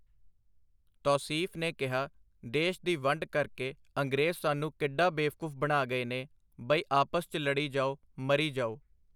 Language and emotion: Punjabi, neutral